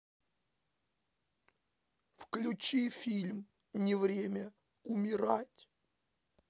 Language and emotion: Russian, sad